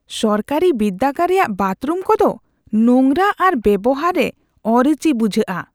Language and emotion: Santali, disgusted